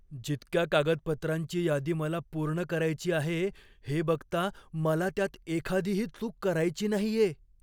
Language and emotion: Marathi, fearful